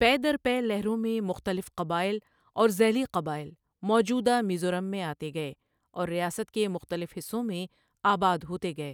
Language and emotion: Urdu, neutral